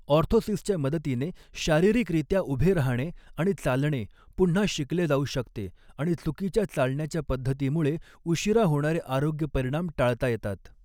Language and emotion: Marathi, neutral